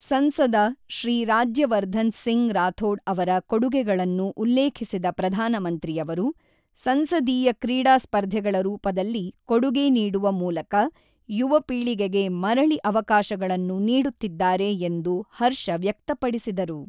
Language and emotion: Kannada, neutral